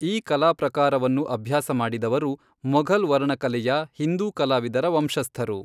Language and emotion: Kannada, neutral